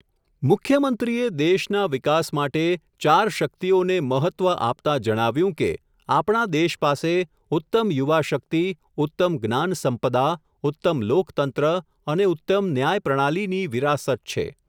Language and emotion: Gujarati, neutral